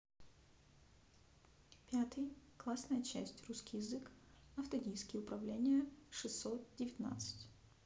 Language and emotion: Russian, neutral